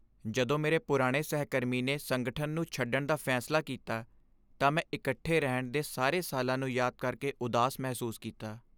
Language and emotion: Punjabi, sad